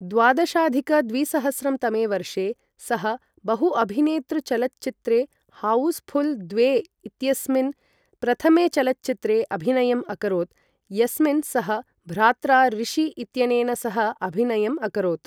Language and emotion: Sanskrit, neutral